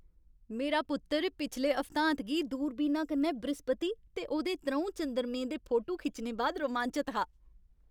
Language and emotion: Dogri, happy